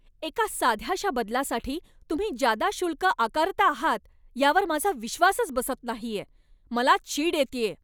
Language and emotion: Marathi, angry